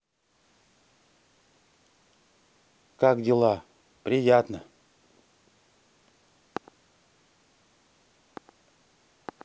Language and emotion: Russian, neutral